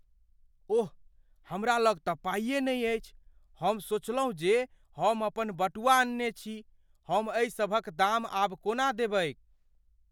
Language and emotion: Maithili, fearful